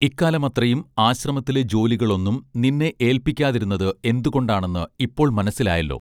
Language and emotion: Malayalam, neutral